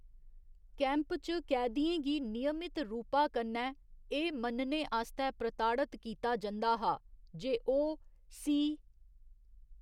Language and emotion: Dogri, neutral